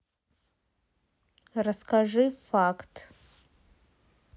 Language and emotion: Russian, neutral